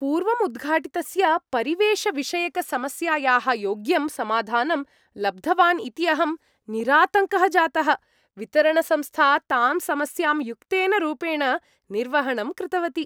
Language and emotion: Sanskrit, happy